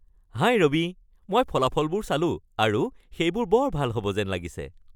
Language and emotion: Assamese, happy